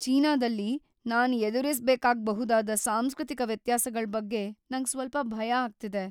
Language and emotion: Kannada, fearful